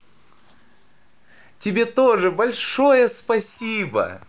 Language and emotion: Russian, positive